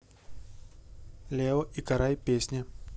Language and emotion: Russian, neutral